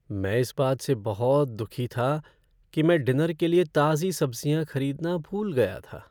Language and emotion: Hindi, sad